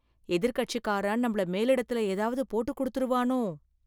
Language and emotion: Tamil, fearful